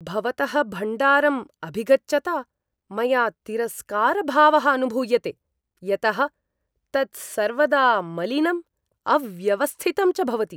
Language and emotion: Sanskrit, disgusted